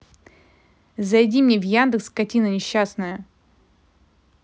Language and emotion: Russian, angry